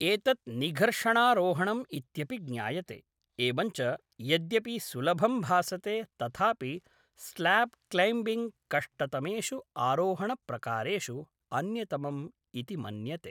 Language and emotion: Sanskrit, neutral